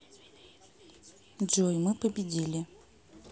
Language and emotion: Russian, neutral